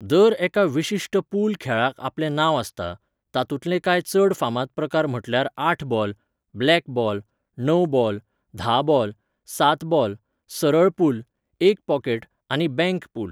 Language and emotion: Goan Konkani, neutral